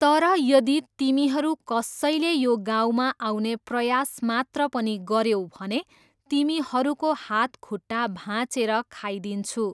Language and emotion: Nepali, neutral